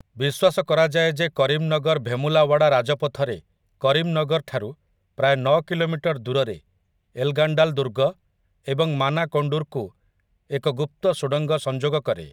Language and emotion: Odia, neutral